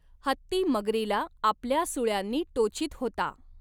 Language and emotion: Marathi, neutral